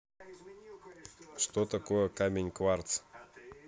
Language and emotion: Russian, neutral